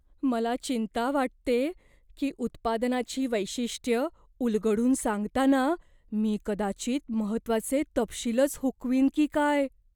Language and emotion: Marathi, fearful